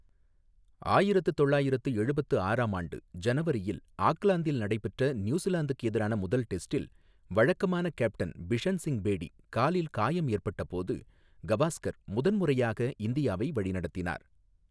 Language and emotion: Tamil, neutral